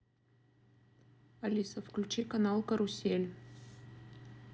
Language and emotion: Russian, neutral